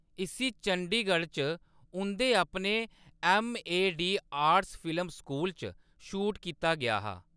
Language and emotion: Dogri, neutral